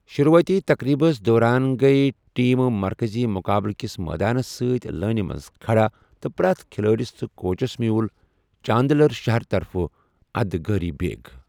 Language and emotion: Kashmiri, neutral